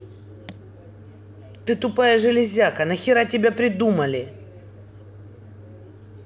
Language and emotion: Russian, angry